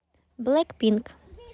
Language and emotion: Russian, neutral